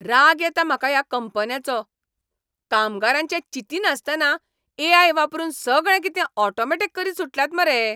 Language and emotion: Goan Konkani, angry